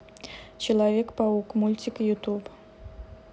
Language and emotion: Russian, neutral